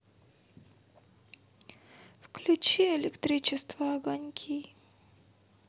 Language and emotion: Russian, sad